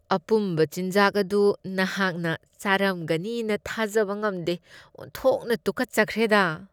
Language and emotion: Manipuri, disgusted